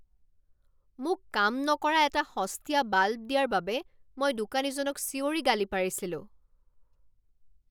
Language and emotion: Assamese, angry